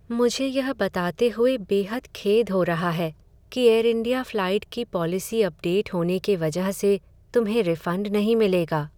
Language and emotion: Hindi, sad